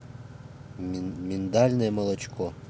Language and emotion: Russian, neutral